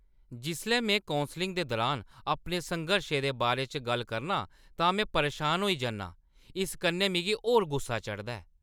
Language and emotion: Dogri, angry